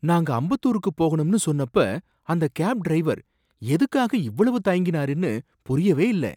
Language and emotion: Tamil, surprised